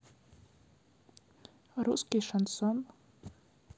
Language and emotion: Russian, neutral